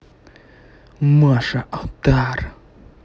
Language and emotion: Russian, angry